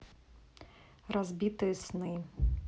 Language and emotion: Russian, neutral